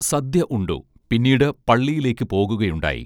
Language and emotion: Malayalam, neutral